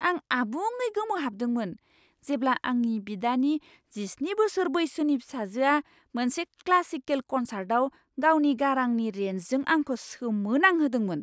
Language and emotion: Bodo, surprised